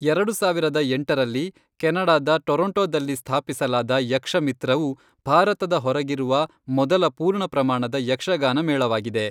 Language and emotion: Kannada, neutral